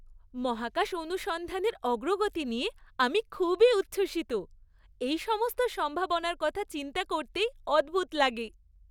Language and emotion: Bengali, happy